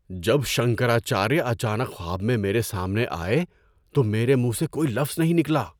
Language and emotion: Urdu, surprised